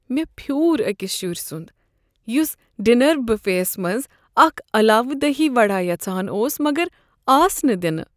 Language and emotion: Kashmiri, sad